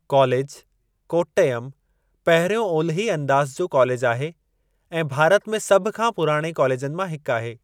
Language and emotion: Sindhi, neutral